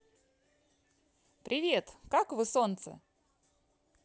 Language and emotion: Russian, positive